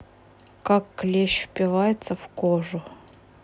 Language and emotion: Russian, neutral